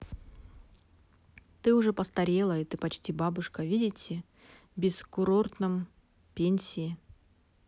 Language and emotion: Russian, neutral